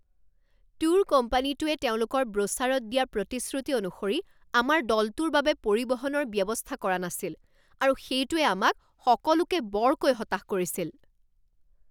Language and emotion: Assamese, angry